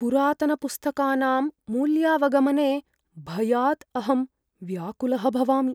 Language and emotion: Sanskrit, fearful